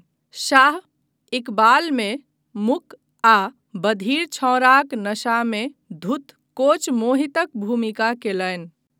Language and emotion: Maithili, neutral